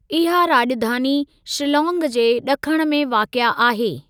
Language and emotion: Sindhi, neutral